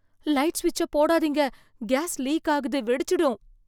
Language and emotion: Tamil, fearful